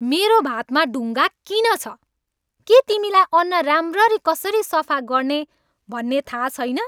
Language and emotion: Nepali, angry